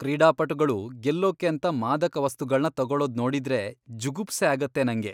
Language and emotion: Kannada, disgusted